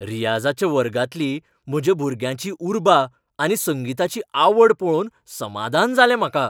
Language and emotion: Goan Konkani, happy